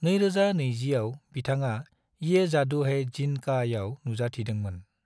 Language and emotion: Bodo, neutral